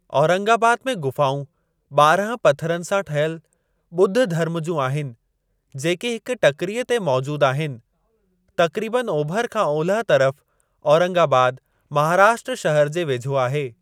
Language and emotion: Sindhi, neutral